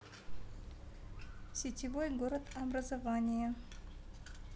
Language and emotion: Russian, neutral